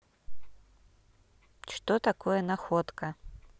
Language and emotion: Russian, neutral